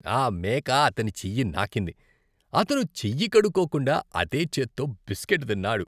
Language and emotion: Telugu, disgusted